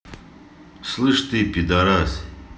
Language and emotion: Russian, angry